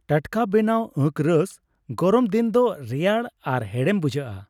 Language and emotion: Santali, happy